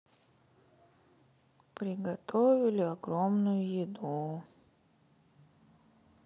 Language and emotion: Russian, sad